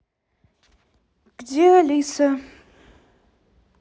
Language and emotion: Russian, neutral